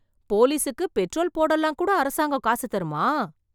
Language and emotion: Tamil, surprised